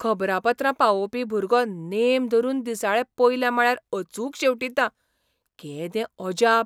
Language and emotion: Goan Konkani, surprised